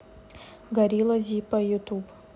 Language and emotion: Russian, neutral